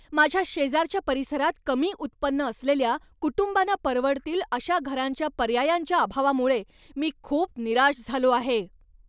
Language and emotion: Marathi, angry